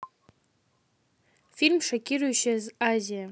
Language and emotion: Russian, neutral